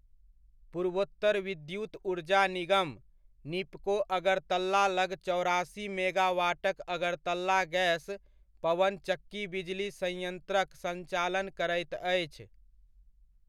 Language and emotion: Maithili, neutral